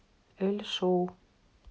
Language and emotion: Russian, neutral